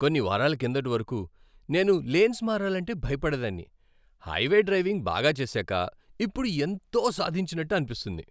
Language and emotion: Telugu, happy